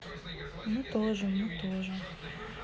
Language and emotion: Russian, neutral